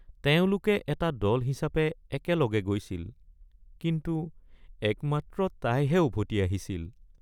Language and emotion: Assamese, sad